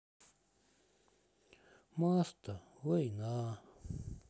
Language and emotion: Russian, sad